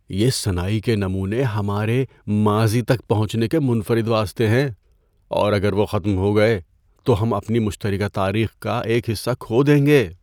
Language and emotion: Urdu, fearful